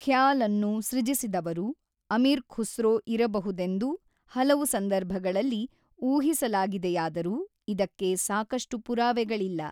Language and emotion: Kannada, neutral